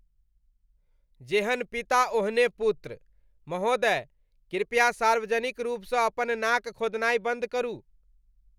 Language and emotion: Maithili, disgusted